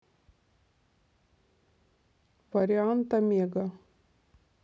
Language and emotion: Russian, neutral